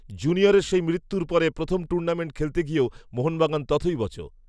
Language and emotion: Bengali, neutral